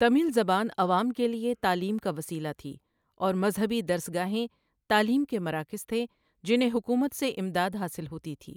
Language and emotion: Urdu, neutral